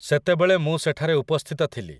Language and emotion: Odia, neutral